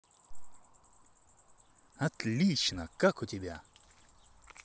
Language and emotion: Russian, positive